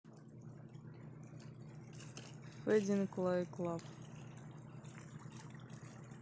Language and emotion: Russian, neutral